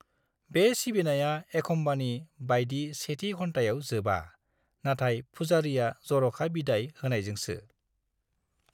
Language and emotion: Bodo, neutral